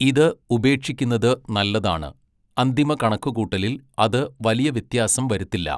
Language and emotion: Malayalam, neutral